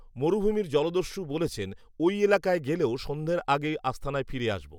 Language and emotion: Bengali, neutral